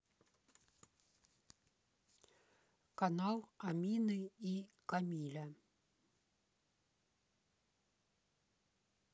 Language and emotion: Russian, neutral